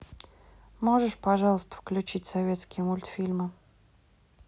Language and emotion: Russian, neutral